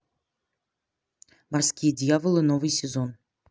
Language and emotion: Russian, neutral